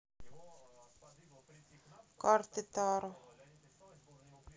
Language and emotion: Russian, neutral